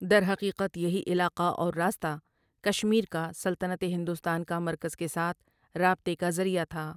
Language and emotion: Urdu, neutral